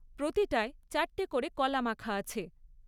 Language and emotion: Bengali, neutral